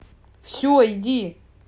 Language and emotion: Russian, angry